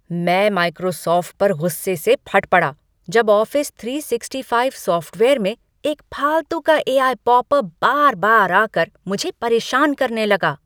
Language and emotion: Hindi, angry